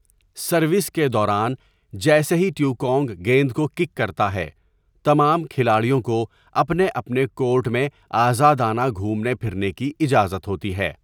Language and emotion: Urdu, neutral